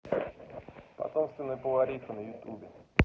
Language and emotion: Russian, neutral